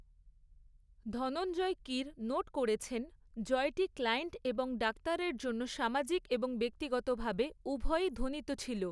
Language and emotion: Bengali, neutral